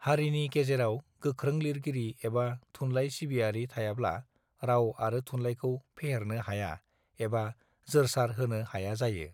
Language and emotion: Bodo, neutral